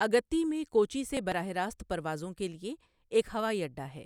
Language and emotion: Urdu, neutral